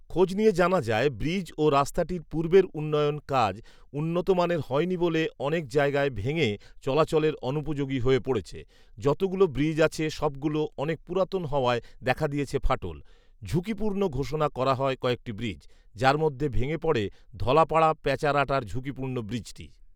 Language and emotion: Bengali, neutral